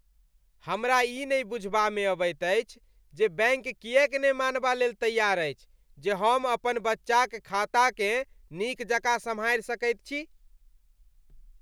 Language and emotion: Maithili, disgusted